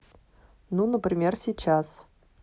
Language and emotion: Russian, neutral